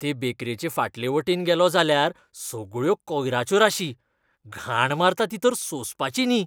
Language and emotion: Goan Konkani, disgusted